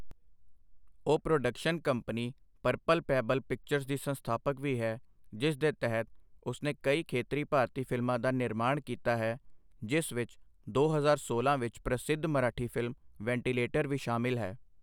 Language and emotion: Punjabi, neutral